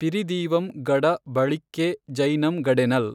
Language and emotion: Kannada, neutral